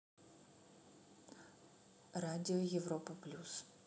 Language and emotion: Russian, neutral